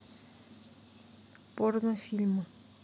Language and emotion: Russian, neutral